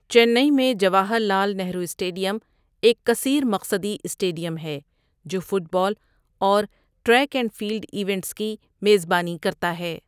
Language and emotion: Urdu, neutral